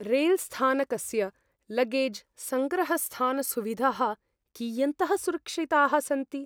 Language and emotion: Sanskrit, fearful